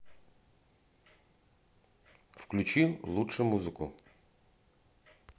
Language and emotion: Russian, neutral